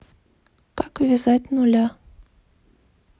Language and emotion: Russian, neutral